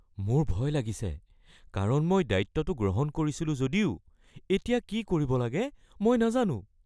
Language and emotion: Assamese, fearful